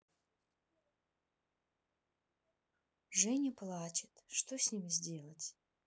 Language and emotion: Russian, sad